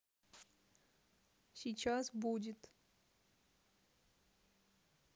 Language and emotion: Russian, neutral